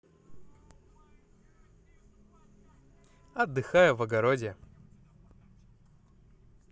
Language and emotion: Russian, positive